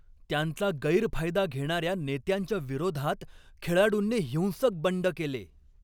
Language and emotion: Marathi, angry